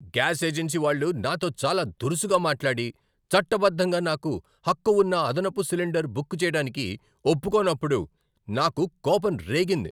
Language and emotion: Telugu, angry